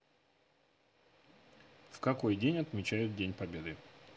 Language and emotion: Russian, neutral